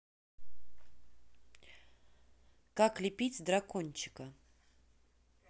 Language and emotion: Russian, neutral